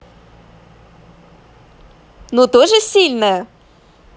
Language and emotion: Russian, positive